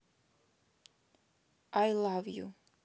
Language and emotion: Russian, neutral